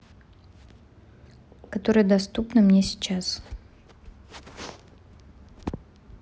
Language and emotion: Russian, neutral